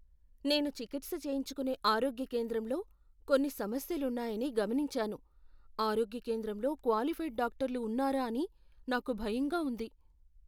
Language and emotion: Telugu, fearful